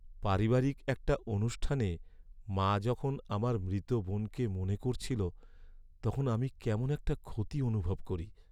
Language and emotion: Bengali, sad